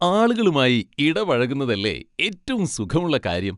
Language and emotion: Malayalam, happy